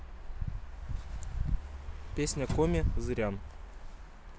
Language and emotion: Russian, neutral